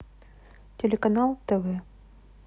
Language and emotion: Russian, neutral